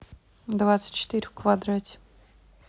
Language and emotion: Russian, neutral